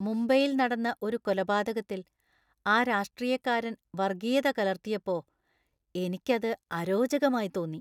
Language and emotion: Malayalam, disgusted